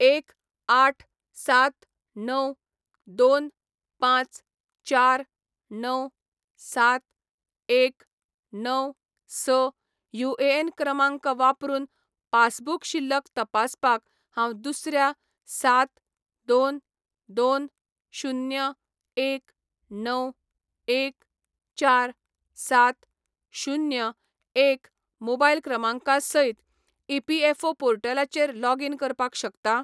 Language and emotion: Goan Konkani, neutral